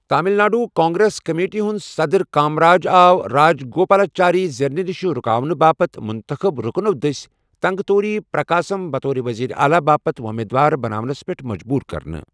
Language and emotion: Kashmiri, neutral